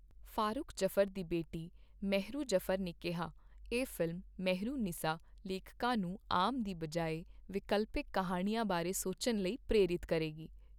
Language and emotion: Punjabi, neutral